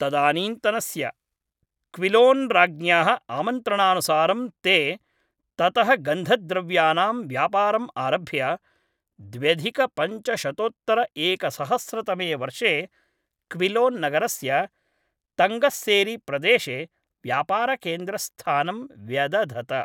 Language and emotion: Sanskrit, neutral